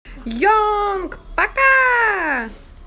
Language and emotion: Russian, positive